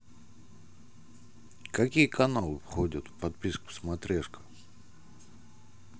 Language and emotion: Russian, neutral